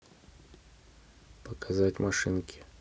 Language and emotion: Russian, neutral